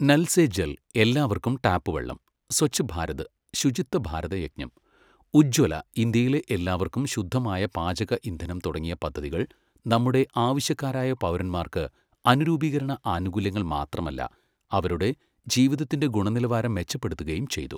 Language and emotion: Malayalam, neutral